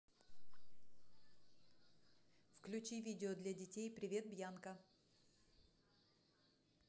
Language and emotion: Russian, neutral